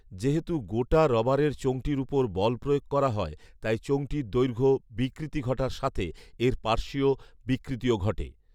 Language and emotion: Bengali, neutral